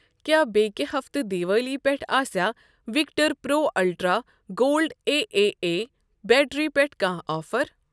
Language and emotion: Kashmiri, neutral